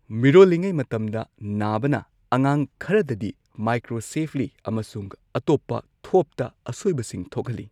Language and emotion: Manipuri, neutral